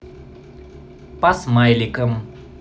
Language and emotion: Russian, positive